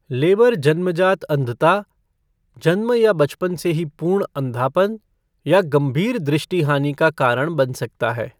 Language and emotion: Hindi, neutral